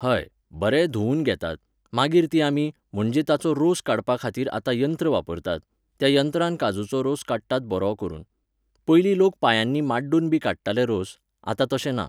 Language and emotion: Goan Konkani, neutral